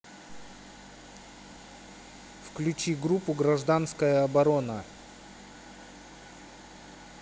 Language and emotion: Russian, neutral